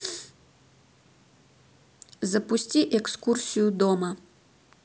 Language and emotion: Russian, neutral